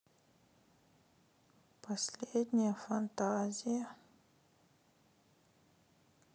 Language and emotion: Russian, sad